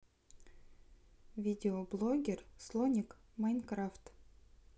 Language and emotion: Russian, neutral